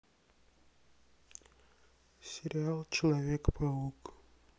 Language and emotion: Russian, sad